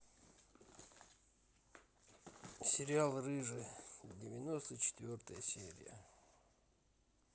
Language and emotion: Russian, neutral